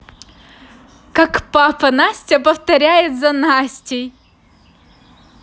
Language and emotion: Russian, positive